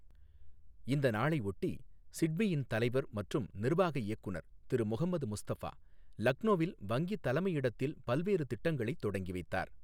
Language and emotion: Tamil, neutral